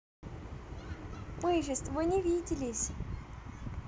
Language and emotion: Russian, positive